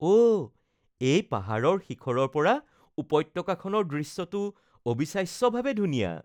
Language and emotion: Assamese, happy